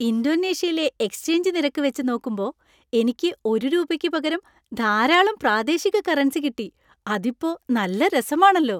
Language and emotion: Malayalam, happy